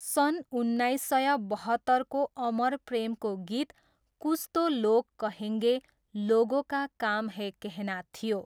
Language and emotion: Nepali, neutral